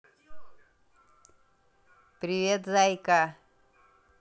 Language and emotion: Russian, positive